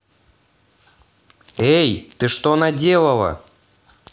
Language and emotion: Russian, angry